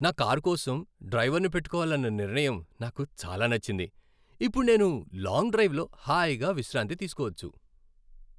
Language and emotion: Telugu, happy